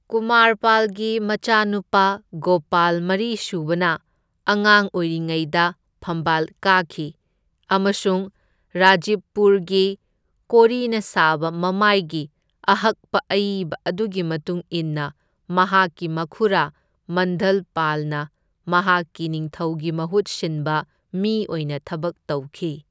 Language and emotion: Manipuri, neutral